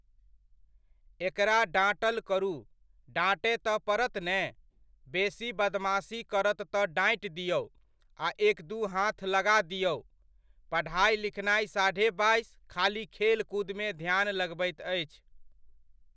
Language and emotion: Maithili, neutral